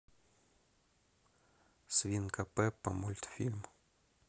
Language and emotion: Russian, neutral